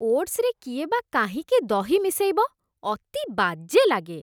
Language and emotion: Odia, disgusted